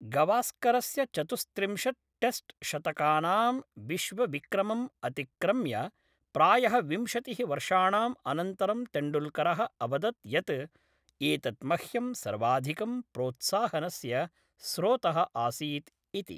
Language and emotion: Sanskrit, neutral